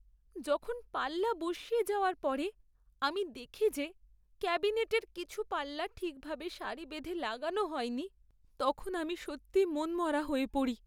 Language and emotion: Bengali, sad